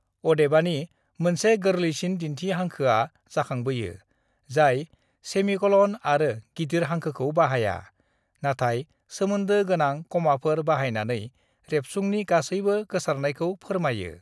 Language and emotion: Bodo, neutral